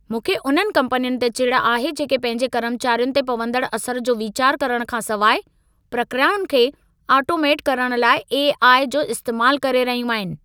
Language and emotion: Sindhi, angry